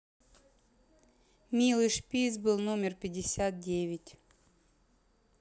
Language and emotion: Russian, neutral